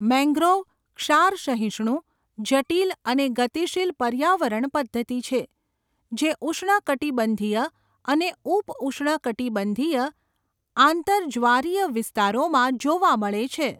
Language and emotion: Gujarati, neutral